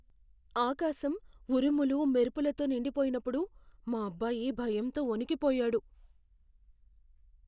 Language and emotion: Telugu, fearful